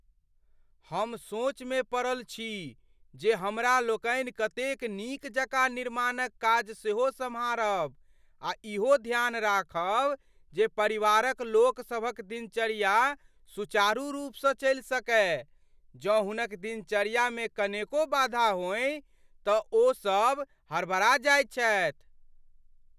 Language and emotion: Maithili, fearful